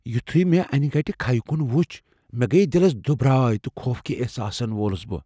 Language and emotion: Kashmiri, fearful